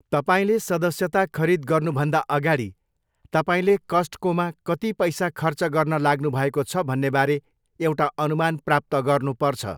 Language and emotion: Nepali, neutral